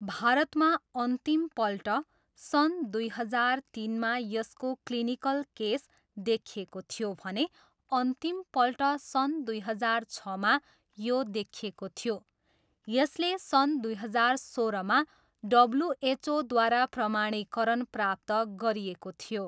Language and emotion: Nepali, neutral